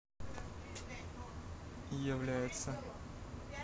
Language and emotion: Russian, neutral